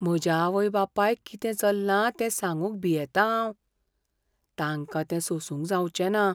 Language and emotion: Goan Konkani, fearful